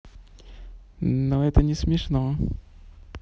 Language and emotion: Russian, positive